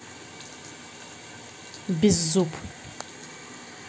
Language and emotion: Russian, neutral